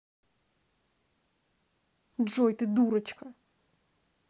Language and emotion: Russian, angry